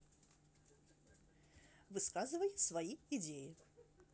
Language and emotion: Russian, neutral